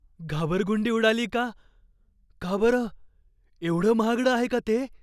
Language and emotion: Marathi, fearful